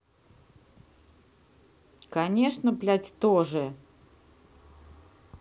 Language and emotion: Russian, angry